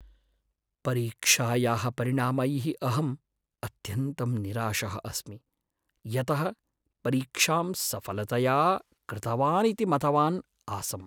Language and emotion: Sanskrit, sad